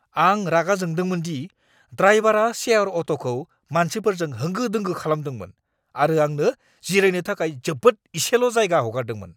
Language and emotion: Bodo, angry